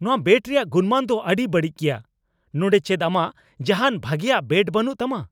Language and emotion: Santali, angry